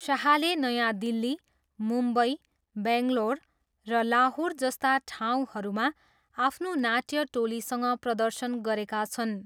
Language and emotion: Nepali, neutral